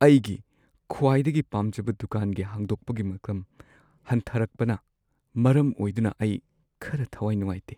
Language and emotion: Manipuri, sad